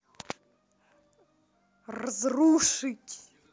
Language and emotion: Russian, neutral